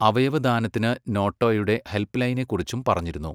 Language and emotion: Malayalam, neutral